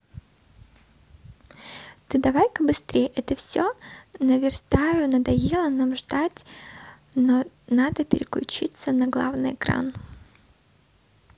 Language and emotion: Russian, neutral